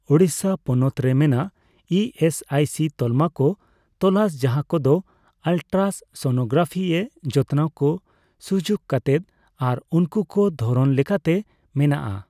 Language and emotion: Santali, neutral